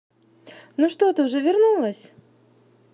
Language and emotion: Russian, positive